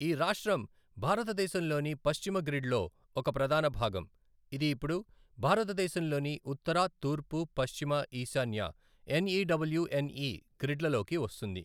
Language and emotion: Telugu, neutral